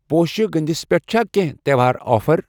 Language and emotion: Kashmiri, neutral